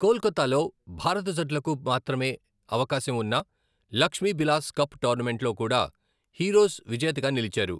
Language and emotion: Telugu, neutral